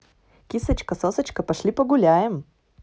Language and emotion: Russian, positive